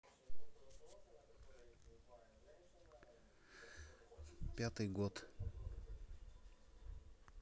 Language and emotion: Russian, neutral